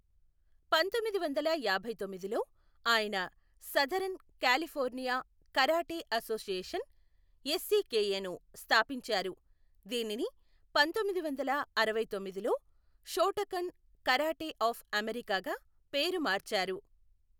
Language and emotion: Telugu, neutral